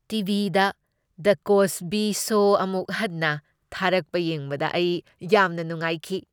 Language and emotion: Manipuri, happy